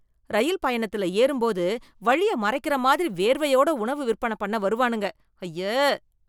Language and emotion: Tamil, disgusted